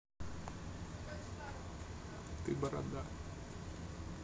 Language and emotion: Russian, neutral